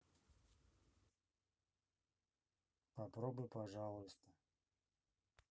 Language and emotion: Russian, neutral